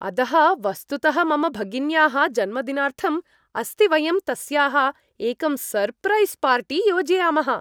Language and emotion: Sanskrit, happy